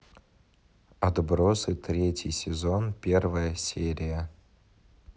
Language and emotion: Russian, neutral